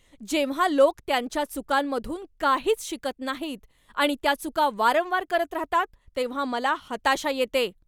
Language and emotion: Marathi, angry